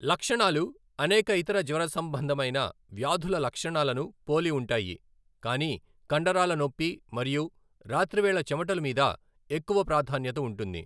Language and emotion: Telugu, neutral